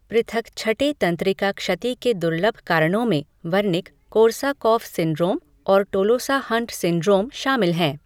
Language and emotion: Hindi, neutral